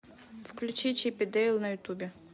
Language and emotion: Russian, neutral